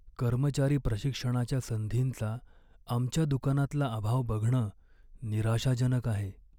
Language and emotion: Marathi, sad